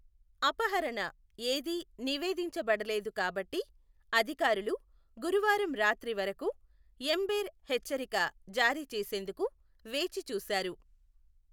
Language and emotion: Telugu, neutral